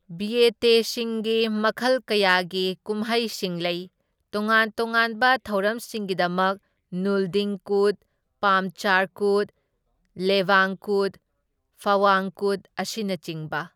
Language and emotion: Manipuri, neutral